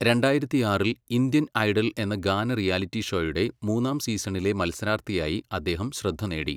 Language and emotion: Malayalam, neutral